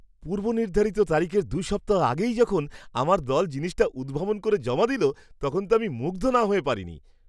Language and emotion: Bengali, surprised